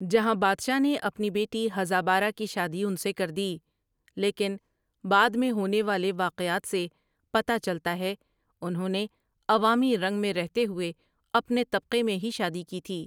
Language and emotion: Urdu, neutral